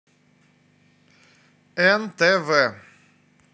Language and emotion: Russian, neutral